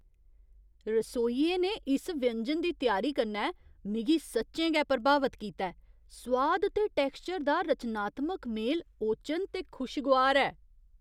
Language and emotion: Dogri, surprised